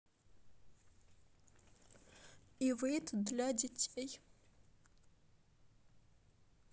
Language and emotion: Russian, sad